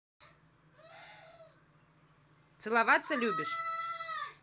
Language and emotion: Russian, neutral